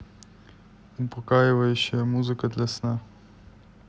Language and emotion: Russian, neutral